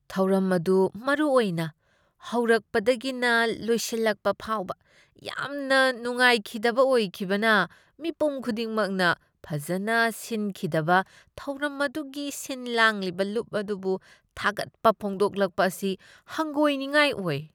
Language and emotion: Manipuri, disgusted